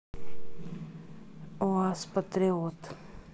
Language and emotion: Russian, neutral